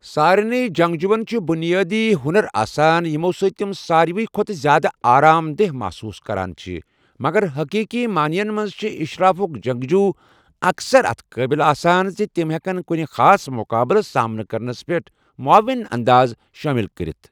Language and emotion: Kashmiri, neutral